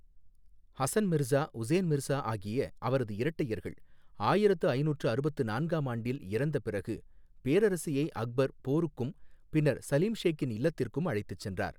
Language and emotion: Tamil, neutral